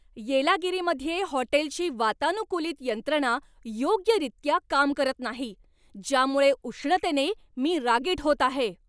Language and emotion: Marathi, angry